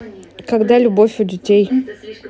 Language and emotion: Russian, neutral